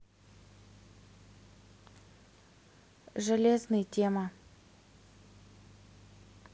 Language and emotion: Russian, neutral